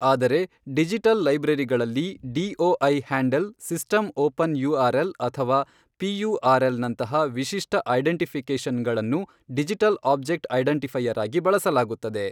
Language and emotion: Kannada, neutral